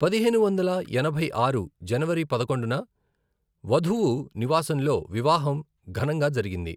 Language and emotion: Telugu, neutral